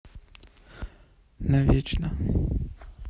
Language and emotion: Russian, sad